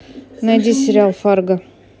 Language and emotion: Russian, neutral